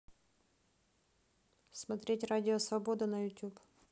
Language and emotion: Russian, neutral